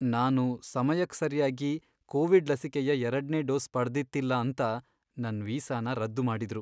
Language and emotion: Kannada, sad